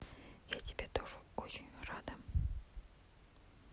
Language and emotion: Russian, neutral